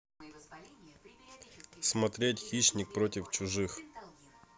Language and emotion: Russian, neutral